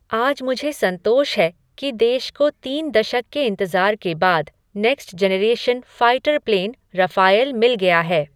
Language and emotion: Hindi, neutral